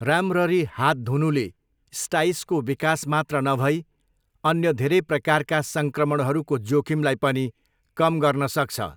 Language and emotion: Nepali, neutral